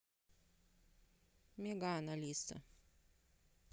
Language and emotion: Russian, neutral